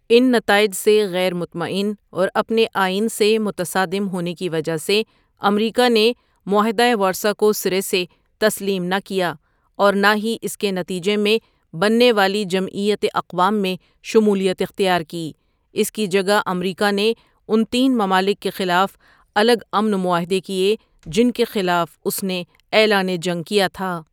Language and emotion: Urdu, neutral